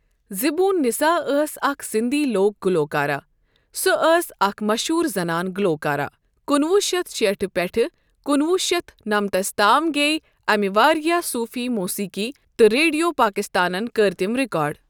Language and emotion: Kashmiri, neutral